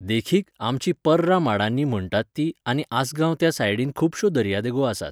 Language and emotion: Goan Konkani, neutral